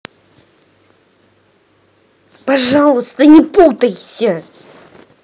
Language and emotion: Russian, angry